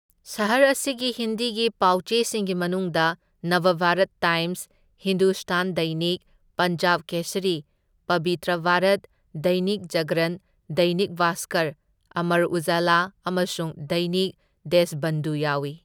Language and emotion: Manipuri, neutral